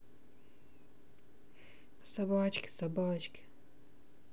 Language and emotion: Russian, sad